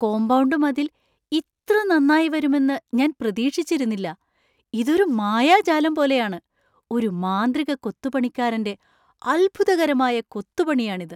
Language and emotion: Malayalam, surprised